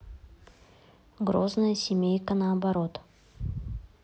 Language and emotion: Russian, neutral